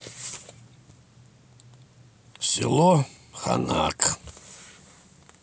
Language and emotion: Russian, neutral